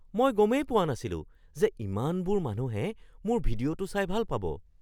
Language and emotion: Assamese, surprised